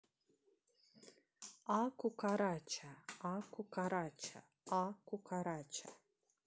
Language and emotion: Russian, neutral